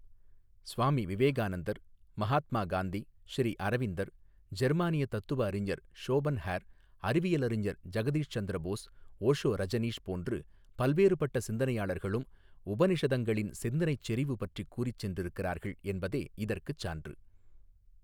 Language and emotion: Tamil, neutral